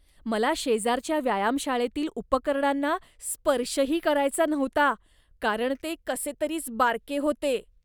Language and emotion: Marathi, disgusted